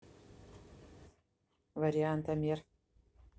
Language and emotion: Russian, neutral